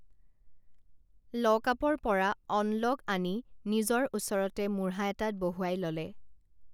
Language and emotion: Assamese, neutral